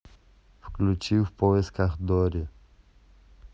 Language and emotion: Russian, neutral